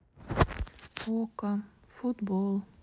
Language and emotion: Russian, sad